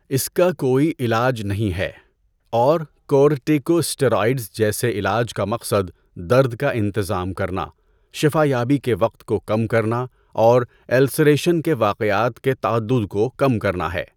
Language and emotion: Urdu, neutral